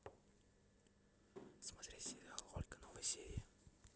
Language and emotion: Russian, neutral